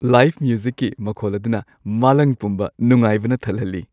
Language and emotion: Manipuri, happy